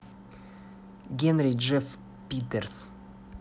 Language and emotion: Russian, neutral